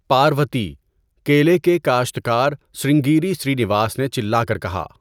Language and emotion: Urdu, neutral